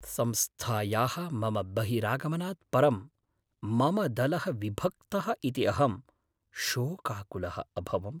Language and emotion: Sanskrit, sad